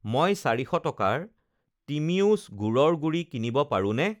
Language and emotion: Assamese, neutral